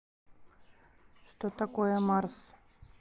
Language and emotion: Russian, neutral